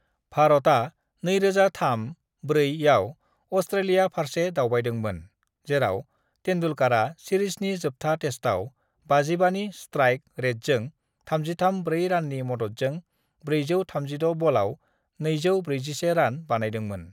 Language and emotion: Bodo, neutral